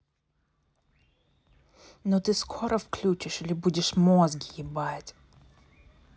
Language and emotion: Russian, angry